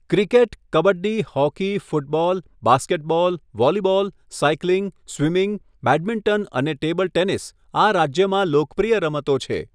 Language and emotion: Gujarati, neutral